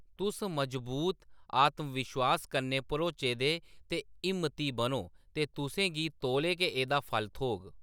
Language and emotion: Dogri, neutral